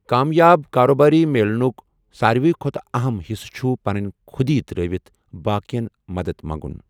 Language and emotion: Kashmiri, neutral